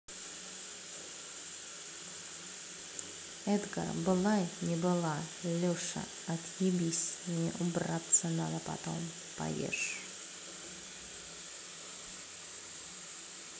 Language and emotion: Russian, neutral